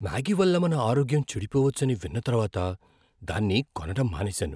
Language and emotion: Telugu, fearful